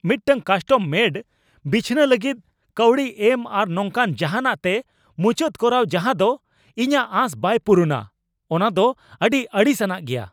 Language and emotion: Santali, angry